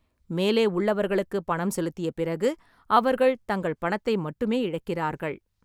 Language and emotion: Tamil, neutral